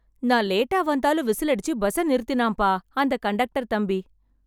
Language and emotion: Tamil, happy